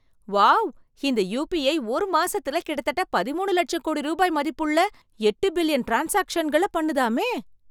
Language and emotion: Tamil, surprised